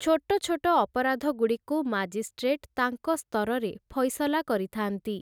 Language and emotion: Odia, neutral